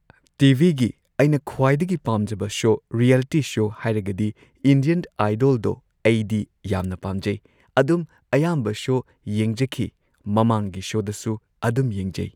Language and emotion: Manipuri, neutral